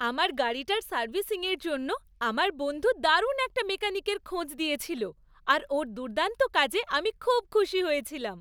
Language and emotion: Bengali, happy